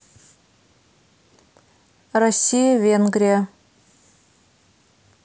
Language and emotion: Russian, neutral